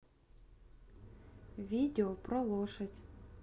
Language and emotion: Russian, neutral